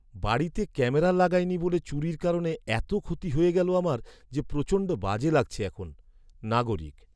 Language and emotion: Bengali, sad